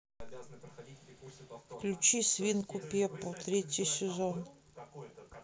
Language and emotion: Russian, neutral